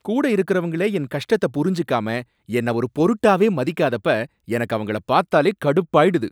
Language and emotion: Tamil, angry